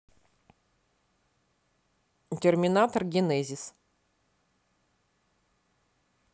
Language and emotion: Russian, neutral